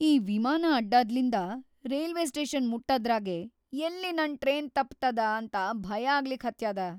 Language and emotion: Kannada, fearful